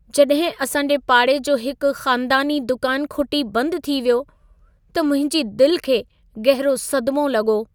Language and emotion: Sindhi, sad